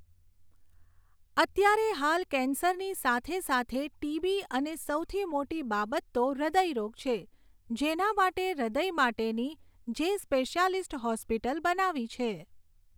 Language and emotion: Gujarati, neutral